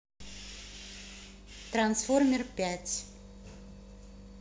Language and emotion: Russian, neutral